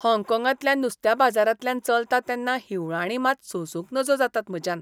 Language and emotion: Goan Konkani, disgusted